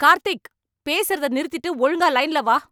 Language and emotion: Tamil, angry